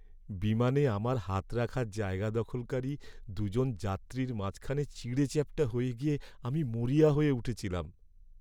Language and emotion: Bengali, sad